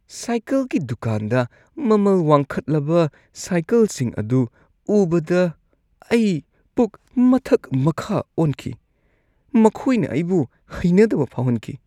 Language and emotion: Manipuri, disgusted